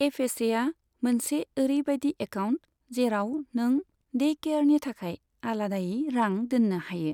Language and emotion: Bodo, neutral